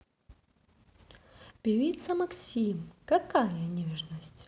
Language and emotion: Russian, positive